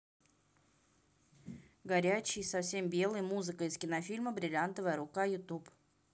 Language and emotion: Russian, neutral